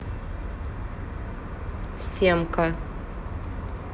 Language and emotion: Russian, neutral